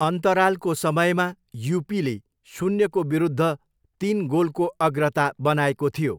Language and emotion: Nepali, neutral